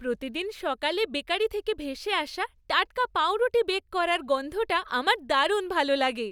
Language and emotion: Bengali, happy